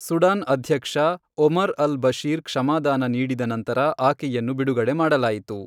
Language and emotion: Kannada, neutral